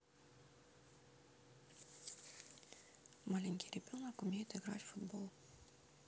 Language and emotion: Russian, neutral